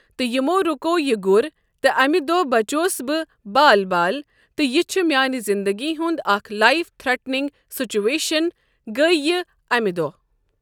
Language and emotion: Kashmiri, neutral